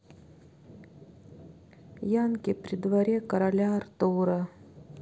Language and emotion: Russian, sad